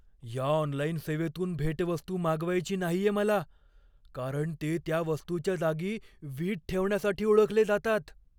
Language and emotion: Marathi, fearful